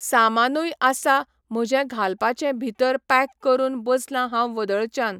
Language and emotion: Goan Konkani, neutral